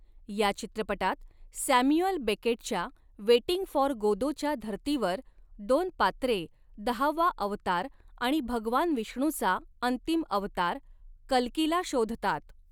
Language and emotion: Marathi, neutral